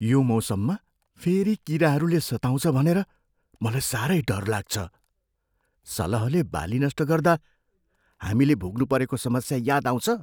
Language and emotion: Nepali, fearful